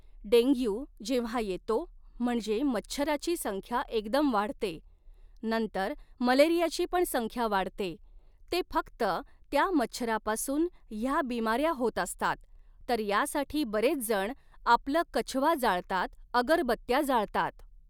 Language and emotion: Marathi, neutral